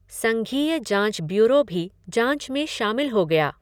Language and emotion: Hindi, neutral